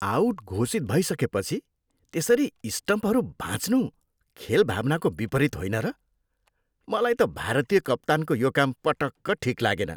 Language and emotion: Nepali, disgusted